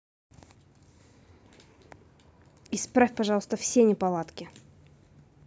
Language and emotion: Russian, angry